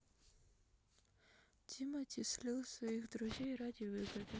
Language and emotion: Russian, sad